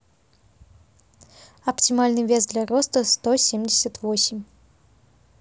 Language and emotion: Russian, neutral